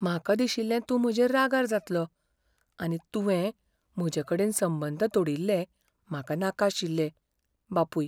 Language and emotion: Goan Konkani, fearful